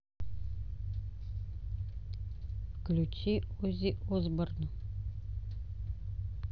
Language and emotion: Russian, neutral